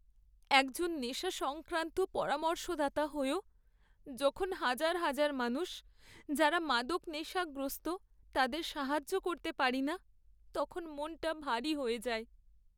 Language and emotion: Bengali, sad